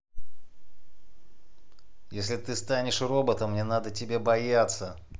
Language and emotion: Russian, angry